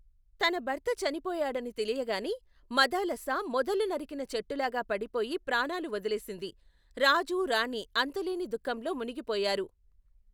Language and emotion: Telugu, neutral